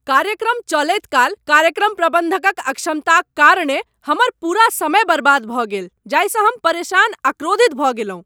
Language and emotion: Maithili, angry